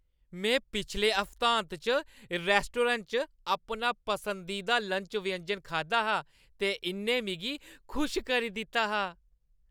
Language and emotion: Dogri, happy